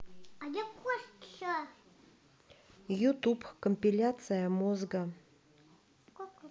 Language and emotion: Russian, neutral